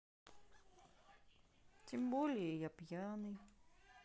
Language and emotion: Russian, sad